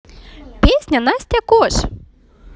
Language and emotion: Russian, positive